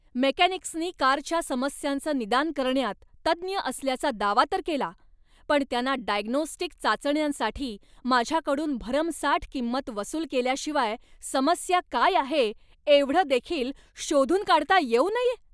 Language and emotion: Marathi, angry